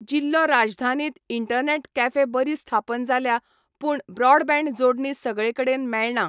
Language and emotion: Goan Konkani, neutral